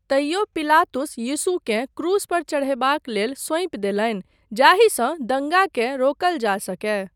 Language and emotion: Maithili, neutral